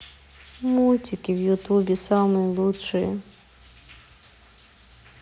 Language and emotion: Russian, sad